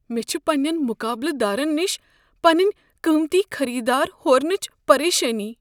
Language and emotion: Kashmiri, fearful